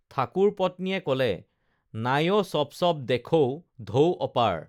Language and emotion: Assamese, neutral